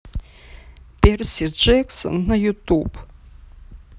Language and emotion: Russian, sad